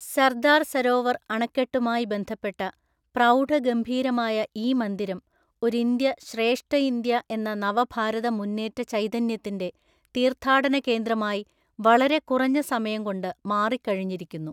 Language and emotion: Malayalam, neutral